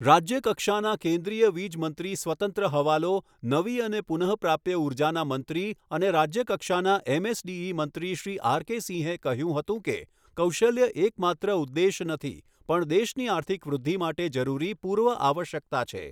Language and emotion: Gujarati, neutral